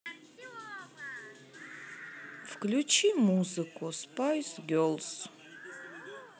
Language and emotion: Russian, sad